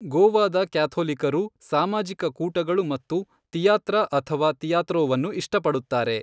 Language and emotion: Kannada, neutral